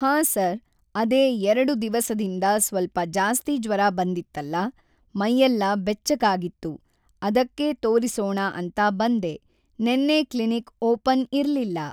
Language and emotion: Kannada, neutral